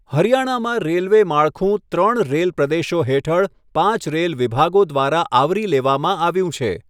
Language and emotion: Gujarati, neutral